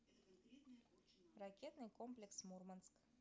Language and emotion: Russian, neutral